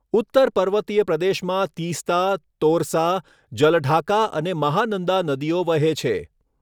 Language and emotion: Gujarati, neutral